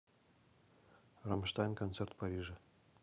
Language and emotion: Russian, neutral